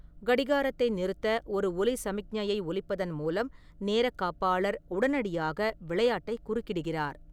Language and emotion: Tamil, neutral